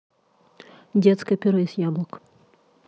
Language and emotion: Russian, neutral